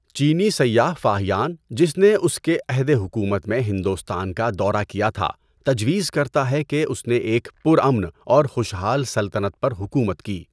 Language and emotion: Urdu, neutral